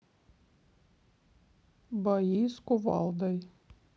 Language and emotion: Russian, neutral